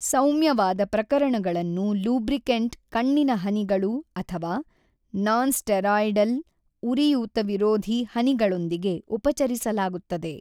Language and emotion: Kannada, neutral